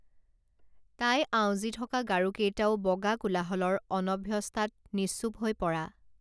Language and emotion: Assamese, neutral